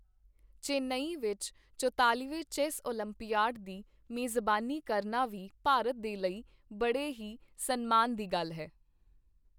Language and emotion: Punjabi, neutral